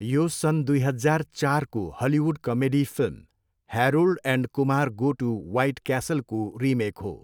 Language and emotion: Nepali, neutral